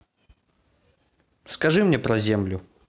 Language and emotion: Russian, neutral